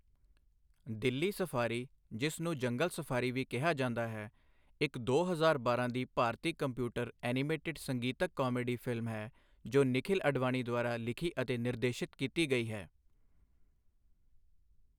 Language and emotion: Punjabi, neutral